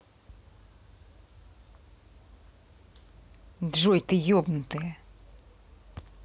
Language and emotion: Russian, angry